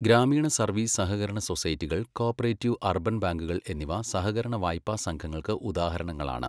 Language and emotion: Malayalam, neutral